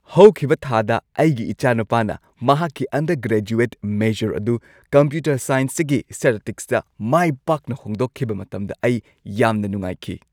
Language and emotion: Manipuri, happy